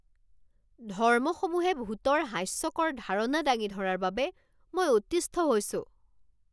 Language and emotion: Assamese, angry